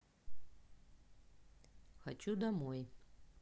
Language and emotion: Russian, neutral